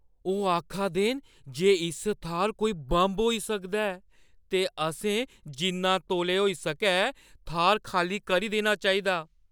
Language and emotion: Dogri, fearful